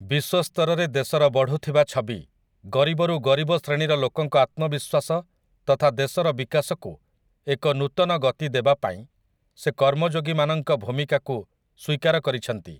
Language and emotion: Odia, neutral